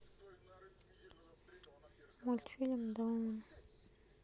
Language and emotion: Russian, sad